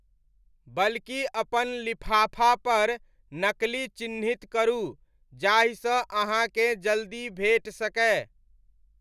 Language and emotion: Maithili, neutral